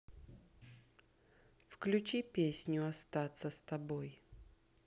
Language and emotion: Russian, neutral